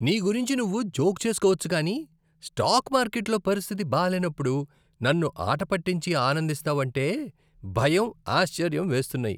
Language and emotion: Telugu, disgusted